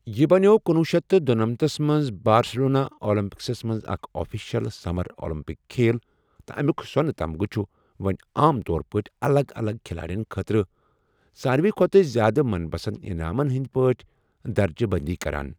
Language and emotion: Kashmiri, neutral